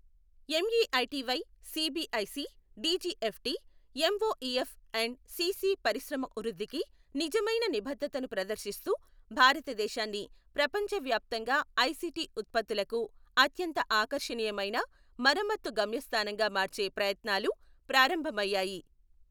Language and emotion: Telugu, neutral